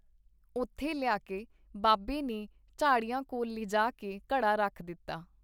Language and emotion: Punjabi, neutral